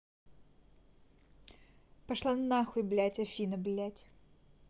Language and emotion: Russian, angry